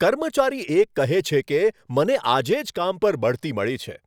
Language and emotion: Gujarati, happy